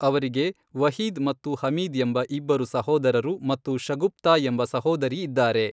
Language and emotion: Kannada, neutral